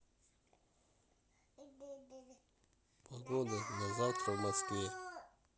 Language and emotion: Russian, neutral